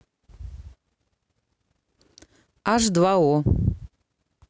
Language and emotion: Russian, neutral